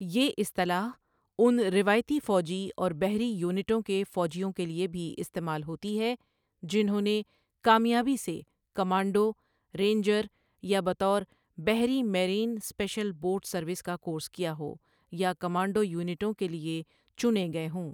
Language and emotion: Urdu, neutral